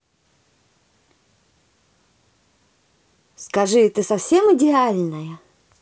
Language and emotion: Russian, positive